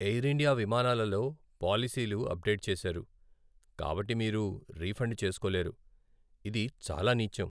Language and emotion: Telugu, sad